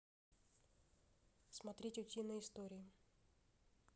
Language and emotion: Russian, neutral